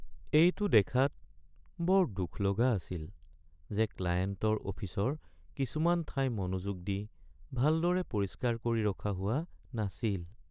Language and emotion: Assamese, sad